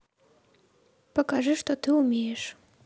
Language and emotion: Russian, neutral